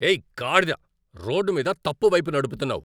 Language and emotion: Telugu, angry